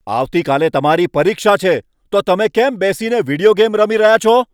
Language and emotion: Gujarati, angry